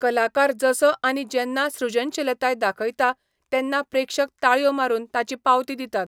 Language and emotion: Goan Konkani, neutral